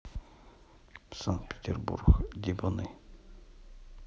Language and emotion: Russian, neutral